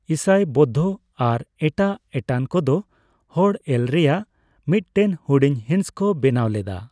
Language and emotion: Santali, neutral